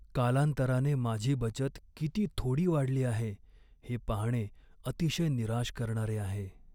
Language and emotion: Marathi, sad